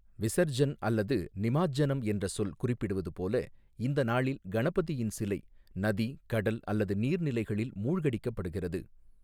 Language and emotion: Tamil, neutral